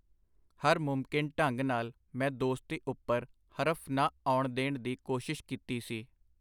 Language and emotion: Punjabi, neutral